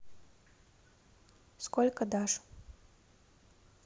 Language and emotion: Russian, neutral